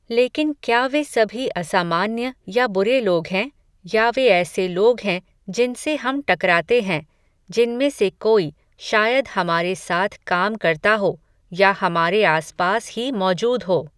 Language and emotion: Hindi, neutral